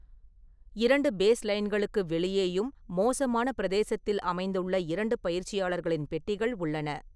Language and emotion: Tamil, neutral